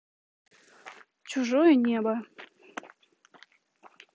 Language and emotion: Russian, neutral